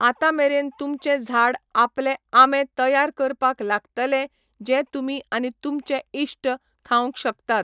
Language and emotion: Goan Konkani, neutral